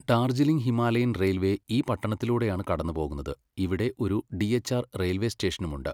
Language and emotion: Malayalam, neutral